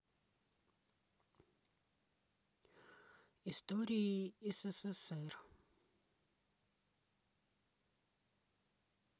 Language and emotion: Russian, neutral